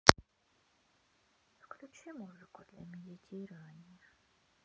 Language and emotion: Russian, sad